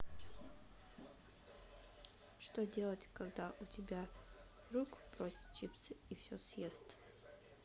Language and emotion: Russian, neutral